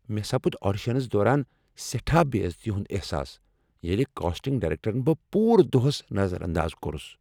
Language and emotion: Kashmiri, angry